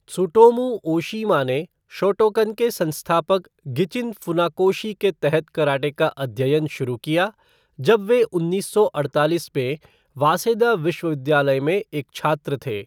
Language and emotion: Hindi, neutral